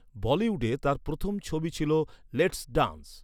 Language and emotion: Bengali, neutral